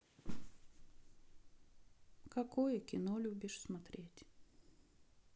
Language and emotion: Russian, sad